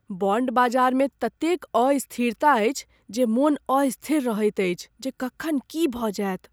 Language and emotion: Maithili, fearful